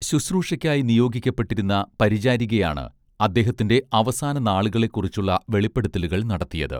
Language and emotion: Malayalam, neutral